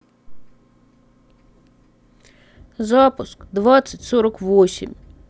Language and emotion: Russian, sad